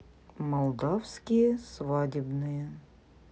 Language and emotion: Russian, neutral